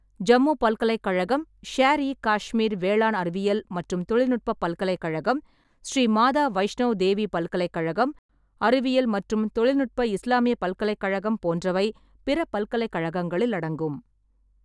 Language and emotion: Tamil, neutral